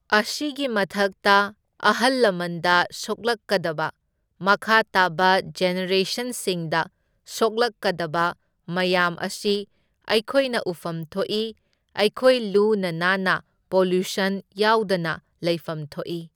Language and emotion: Manipuri, neutral